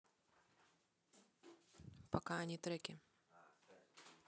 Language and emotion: Russian, neutral